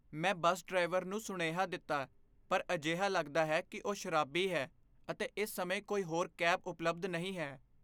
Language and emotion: Punjabi, fearful